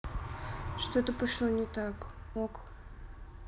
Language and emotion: Russian, neutral